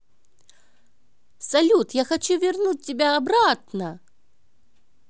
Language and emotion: Russian, positive